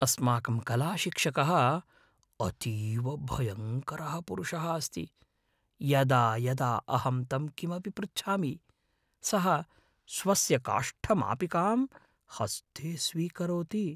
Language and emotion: Sanskrit, fearful